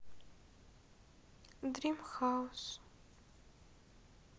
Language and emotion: Russian, sad